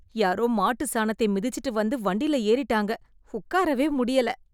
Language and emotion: Tamil, disgusted